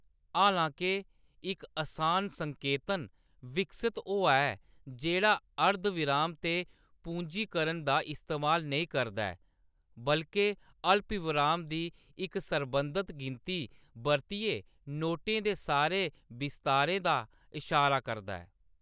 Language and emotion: Dogri, neutral